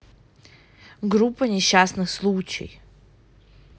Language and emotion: Russian, angry